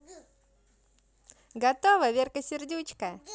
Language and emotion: Russian, positive